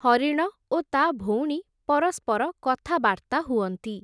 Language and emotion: Odia, neutral